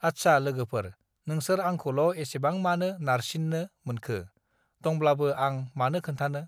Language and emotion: Bodo, neutral